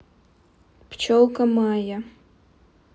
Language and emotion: Russian, neutral